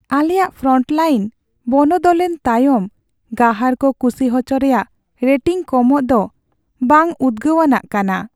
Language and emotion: Santali, sad